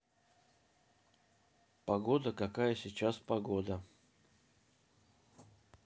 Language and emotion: Russian, neutral